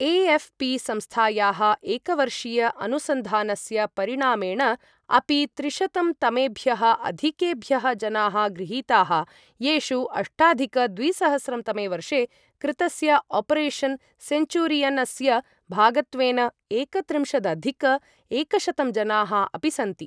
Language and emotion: Sanskrit, neutral